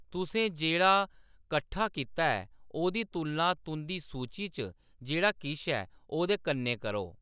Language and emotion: Dogri, neutral